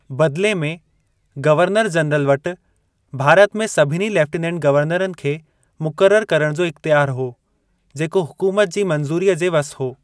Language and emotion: Sindhi, neutral